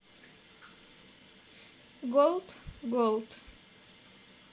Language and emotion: Russian, neutral